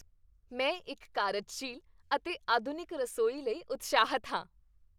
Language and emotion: Punjabi, happy